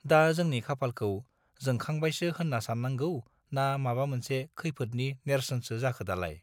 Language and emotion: Bodo, neutral